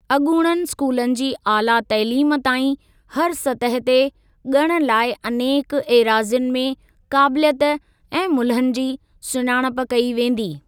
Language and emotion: Sindhi, neutral